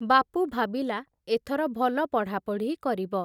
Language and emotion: Odia, neutral